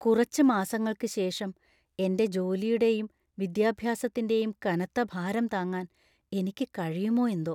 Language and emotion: Malayalam, fearful